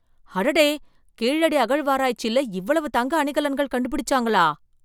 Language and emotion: Tamil, surprised